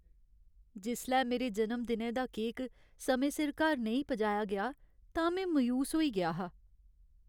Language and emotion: Dogri, sad